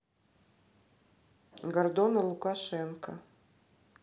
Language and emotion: Russian, neutral